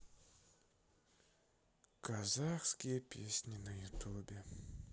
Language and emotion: Russian, sad